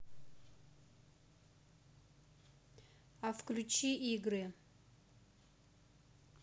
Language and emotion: Russian, neutral